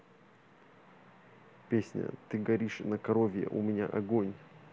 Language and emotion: Russian, neutral